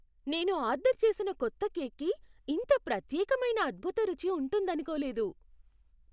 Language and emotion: Telugu, surprised